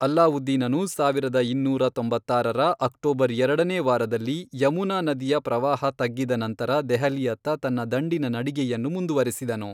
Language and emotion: Kannada, neutral